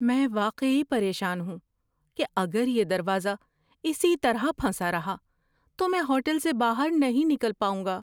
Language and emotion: Urdu, fearful